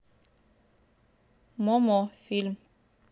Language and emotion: Russian, neutral